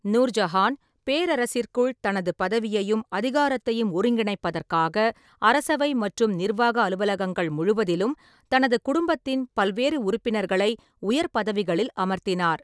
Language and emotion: Tamil, neutral